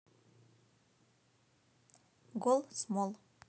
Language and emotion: Russian, neutral